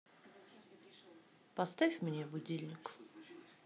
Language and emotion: Russian, neutral